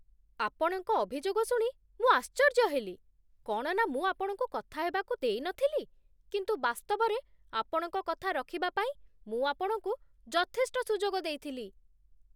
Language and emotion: Odia, surprised